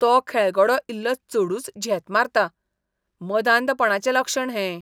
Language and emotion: Goan Konkani, disgusted